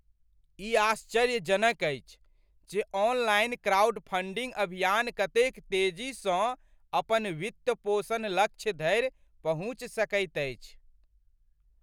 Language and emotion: Maithili, surprised